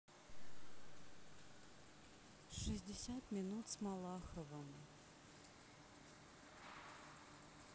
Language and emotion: Russian, neutral